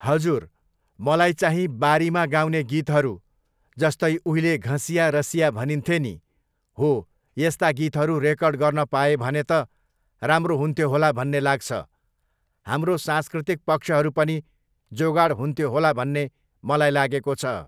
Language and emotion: Nepali, neutral